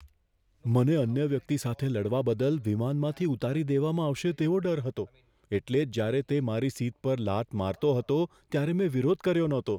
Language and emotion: Gujarati, fearful